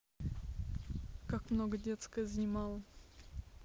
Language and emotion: Russian, neutral